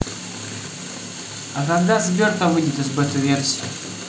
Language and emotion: Russian, neutral